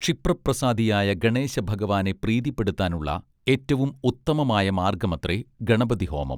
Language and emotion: Malayalam, neutral